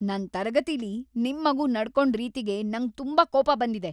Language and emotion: Kannada, angry